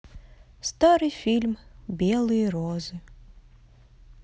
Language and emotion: Russian, sad